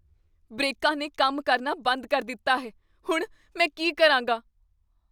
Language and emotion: Punjabi, fearful